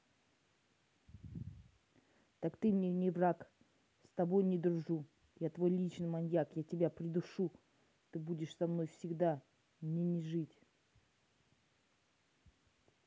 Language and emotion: Russian, angry